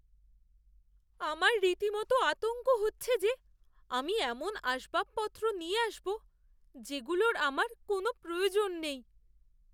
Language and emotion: Bengali, fearful